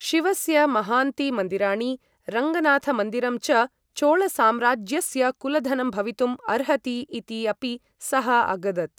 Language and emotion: Sanskrit, neutral